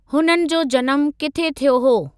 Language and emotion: Sindhi, neutral